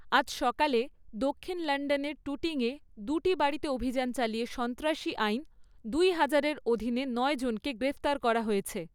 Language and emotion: Bengali, neutral